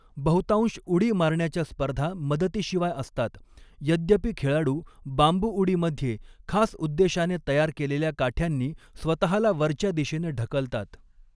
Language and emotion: Marathi, neutral